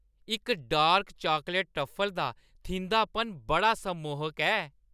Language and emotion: Dogri, happy